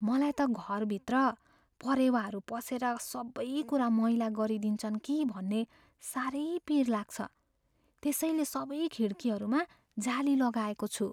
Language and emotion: Nepali, fearful